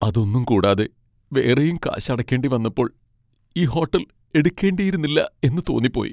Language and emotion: Malayalam, sad